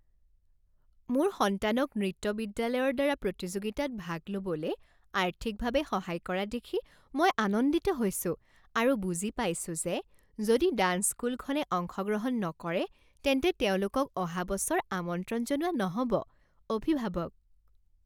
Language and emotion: Assamese, happy